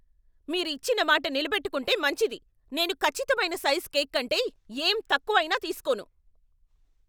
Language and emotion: Telugu, angry